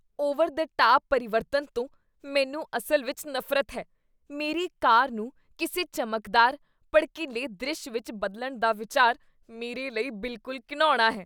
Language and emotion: Punjabi, disgusted